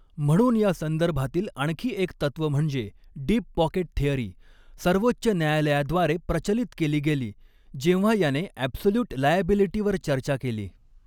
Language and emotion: Marathi, neutral